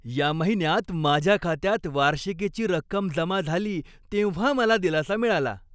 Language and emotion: Marathi, happy